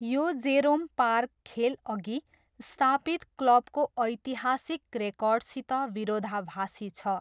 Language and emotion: Nepali, neutral